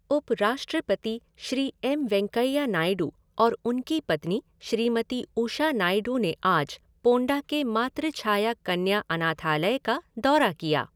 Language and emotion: Hindi, neutral